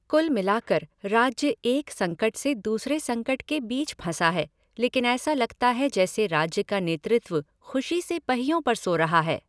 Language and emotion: Hindi, neutral